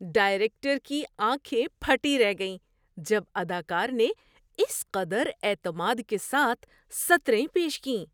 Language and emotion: Urdu, surprised